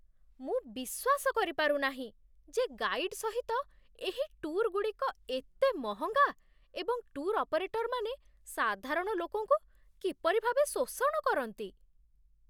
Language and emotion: Odia, disgusted